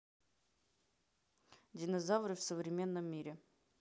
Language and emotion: Russian, neutral